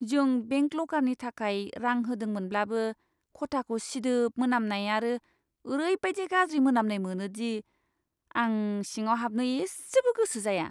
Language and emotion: Bodo, disgusted